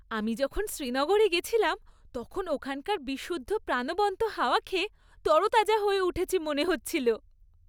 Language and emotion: Bengali, happy